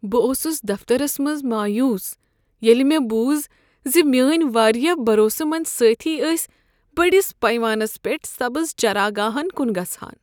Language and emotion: Kashmiri, sad